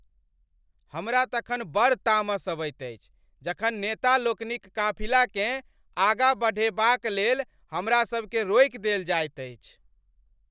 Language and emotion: Maithili, angry